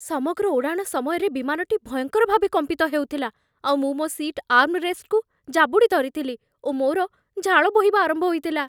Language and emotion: Odia, fearful